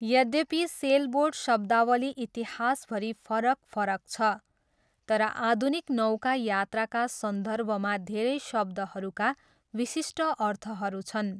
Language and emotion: Nepali, neutral